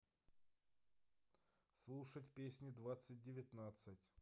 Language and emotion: Russian, neutral